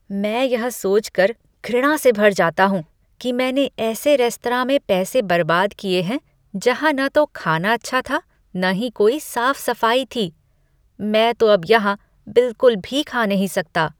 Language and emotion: Hindi, disgusted